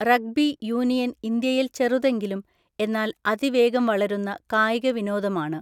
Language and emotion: Malayalam, neutral